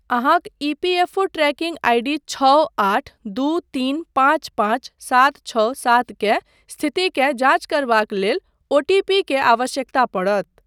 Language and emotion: Maithili, neutral